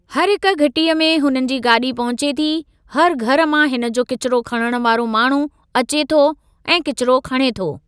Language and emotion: Sindhi, neutral